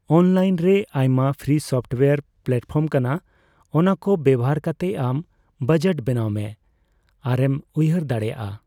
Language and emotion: Santali, neutral